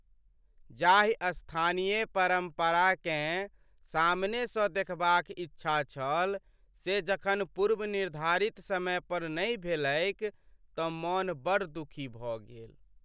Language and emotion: Maithili, sad